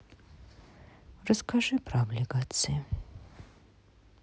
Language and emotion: Russian, sad